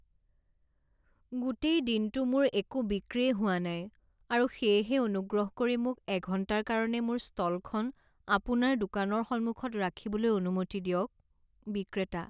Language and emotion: Assamese, sad